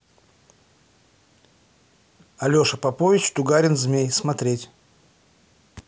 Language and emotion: Russian, neutral